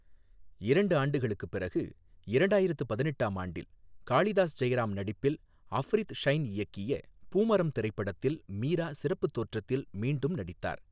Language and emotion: Tamil, neutral